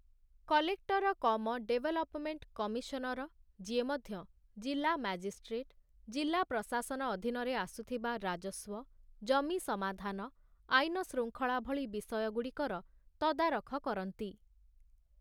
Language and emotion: Odia, neutral